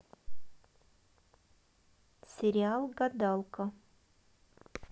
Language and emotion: Russian, neutral